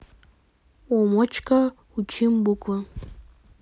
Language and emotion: Russian, neutral